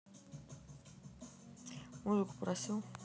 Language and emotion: Russian, neutral